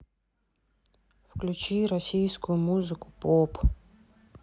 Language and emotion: Russian, sad